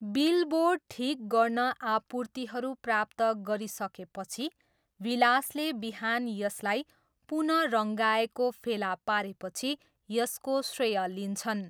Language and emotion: Nepali, neutral